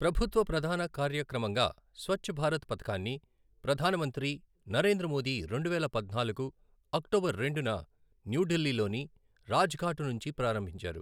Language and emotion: Telugu, neutral